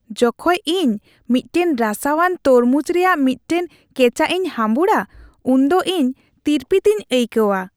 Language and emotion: Santali, happy